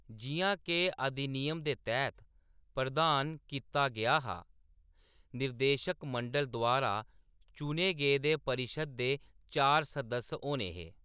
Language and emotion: Dogri, neutral